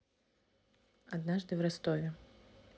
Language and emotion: Russian, neutral